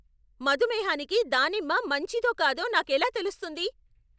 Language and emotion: Telugu, angry